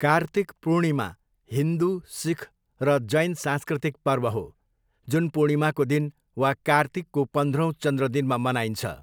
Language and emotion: Nepali, neutral